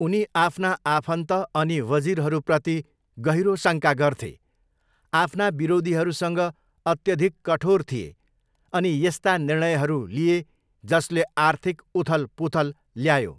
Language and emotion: Nepali, neutral